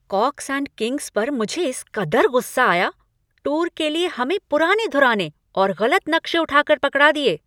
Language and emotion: Hindi, angry